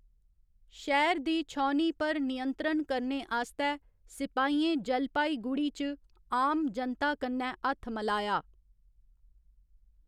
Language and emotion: Dogri, neutral